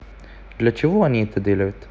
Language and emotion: Russian, neutral